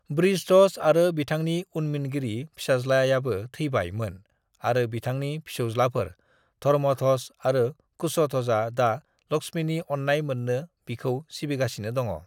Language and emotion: Bodo, neutral